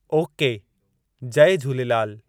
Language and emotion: Sindhi, neutral